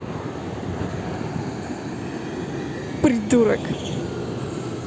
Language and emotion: Russian, positive